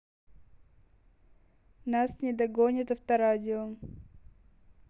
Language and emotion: Russian, neutral